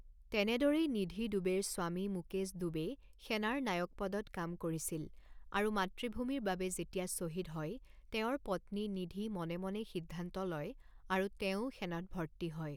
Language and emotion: Assamese, neutral